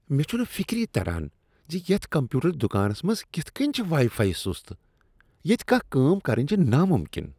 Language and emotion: Kashmiri, disgusted